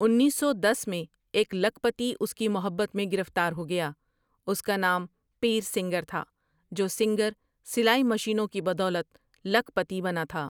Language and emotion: Urdu, neutral